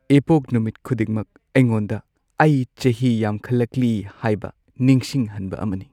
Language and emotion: Manipuri, sad